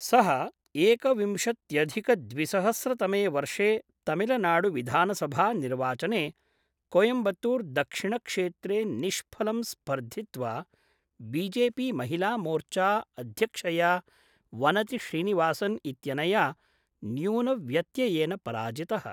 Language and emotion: Sanskrit, neutral